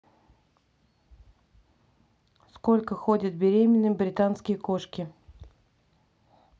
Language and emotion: Russian, neutral